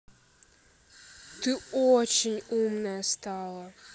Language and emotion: Russian, neutral